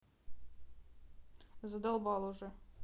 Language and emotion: Russian, neutral